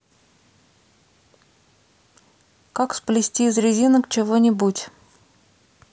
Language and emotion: Russian, neutral